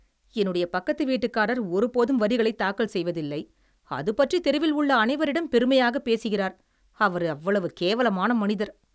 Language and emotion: Tamil, disgusted